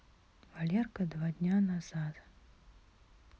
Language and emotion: Russian, neutral